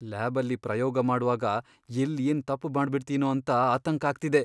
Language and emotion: Kannada, fearful